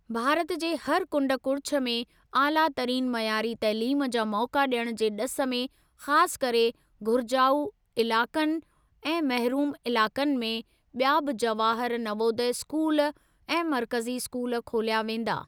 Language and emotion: Sindhi, neutral